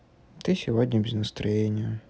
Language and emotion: Russian, sad